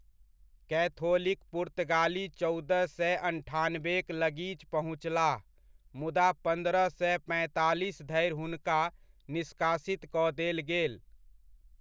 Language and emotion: Maithili, neutral